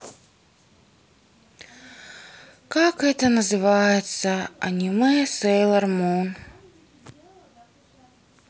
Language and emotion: Russian, sad